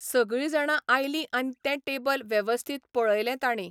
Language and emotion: Goan Konkani, neutral